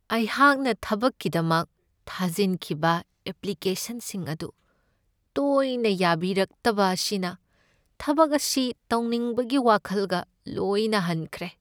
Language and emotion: Manipuri, sad